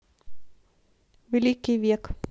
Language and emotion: Russian, neutral